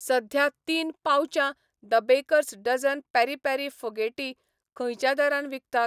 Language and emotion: Goan Konkani, neutral